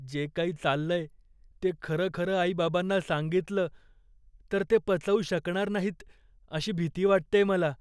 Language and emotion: Marathi, fearful